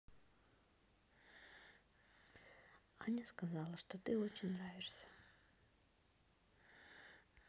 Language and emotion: Russian, neutral